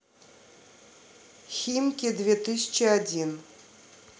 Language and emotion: Russian, neutral